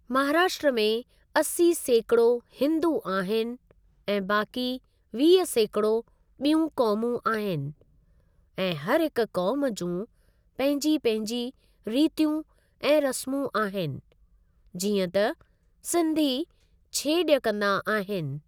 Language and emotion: Sindhi, neutral